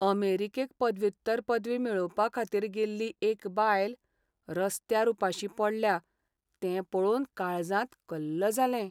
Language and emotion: Goan Konkani, sad